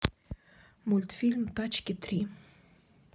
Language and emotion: Russian, neutral